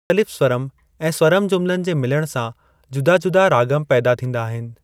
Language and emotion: Sindhi, neutral